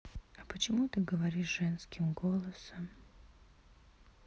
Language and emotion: Russian, sad